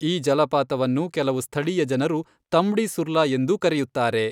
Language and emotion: Kannada, neutral